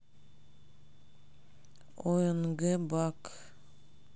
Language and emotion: Russian, sad